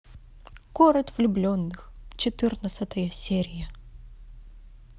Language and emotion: Russian, positive